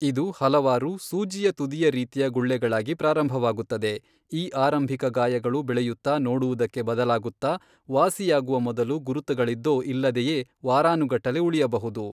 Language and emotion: Kannada, neutral